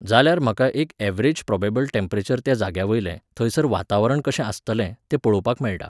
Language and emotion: Goan Konkani, neutral